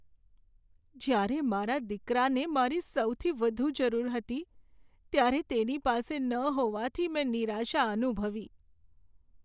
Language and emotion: Gujarati, sad